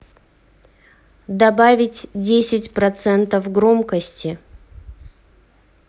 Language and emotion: Russian, neutral